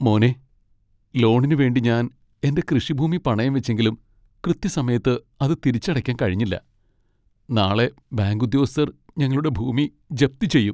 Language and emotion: Malayalam, sad